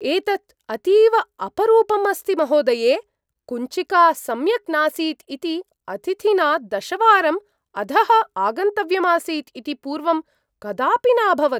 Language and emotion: Sanskrit, surprised